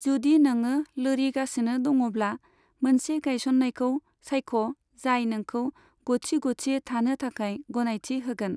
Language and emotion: Bodo, neutral